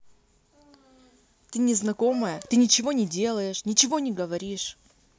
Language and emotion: Russian, angry